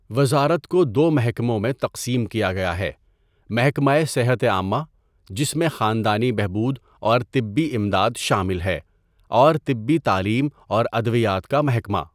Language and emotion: Urdu, neutral